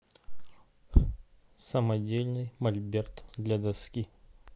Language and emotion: Russian, neutral